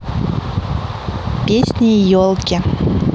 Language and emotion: Russian, neutral